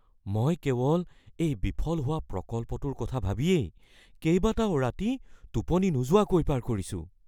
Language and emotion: Assamese, fearful